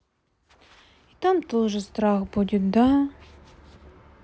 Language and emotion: Russian, sad